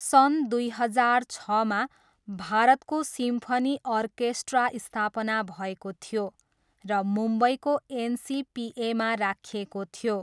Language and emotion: Nepali, neutral